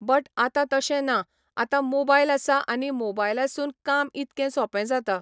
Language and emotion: Goan Konkani, neutral